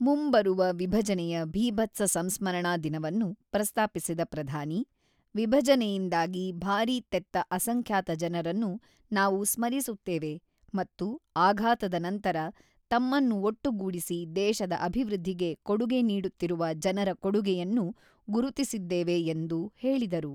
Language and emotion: Kannada, neutral